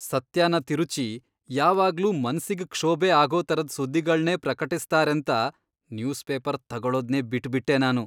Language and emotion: Kannada, disgusted